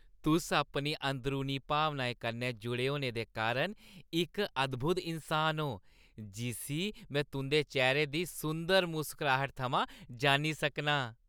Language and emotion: Dogri, happy